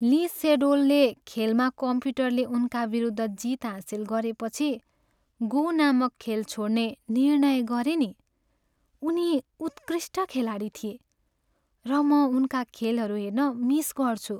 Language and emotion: Nepali, sad